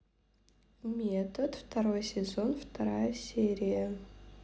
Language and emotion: Russian, neutral